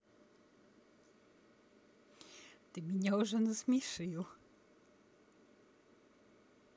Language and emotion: Russian, positive